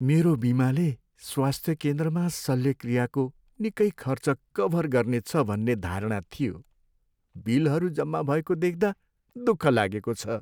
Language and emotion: Nepali, sad